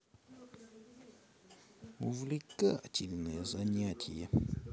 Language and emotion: Russian, positive